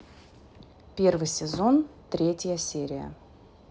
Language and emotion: Russian, neutral